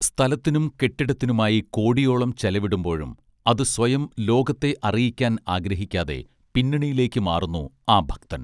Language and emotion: Malayalam, neutral